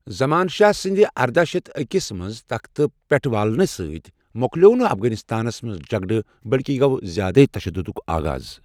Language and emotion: Kashmiri, neutral